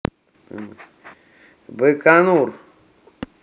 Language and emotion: Russian, neutral